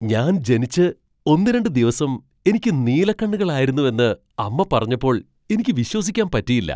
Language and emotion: Malayalam, surprised